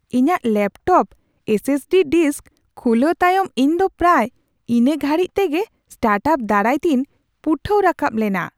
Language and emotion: Santali, surprised